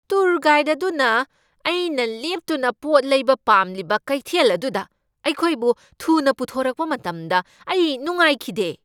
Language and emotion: Manipuri, angry